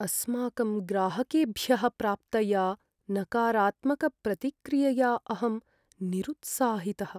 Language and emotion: Sanskrit, sad